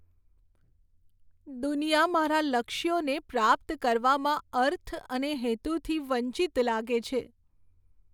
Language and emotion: Gujarati, sad